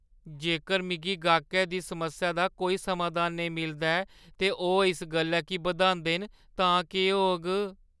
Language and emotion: Dogri, fearful